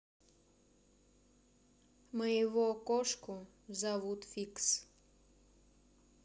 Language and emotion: Russian, neutral